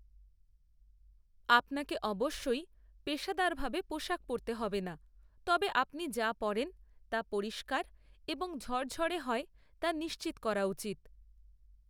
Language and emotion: Bengali, neutral